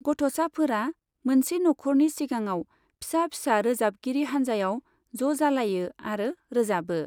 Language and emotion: Bodo, neutral